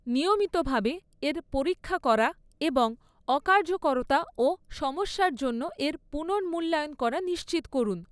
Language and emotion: Bengali, neutral